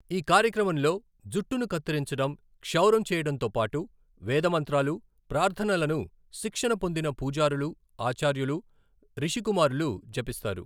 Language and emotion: Telugu, neutral